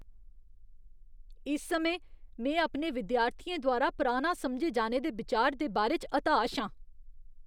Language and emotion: Dogri, disgusted